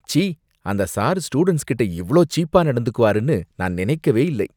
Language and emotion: Tamil, disgusted